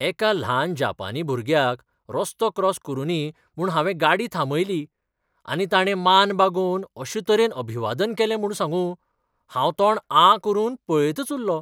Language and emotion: Goan Konkani, surprised